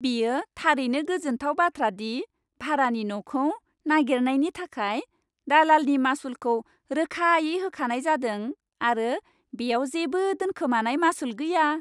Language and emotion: Bodo, happy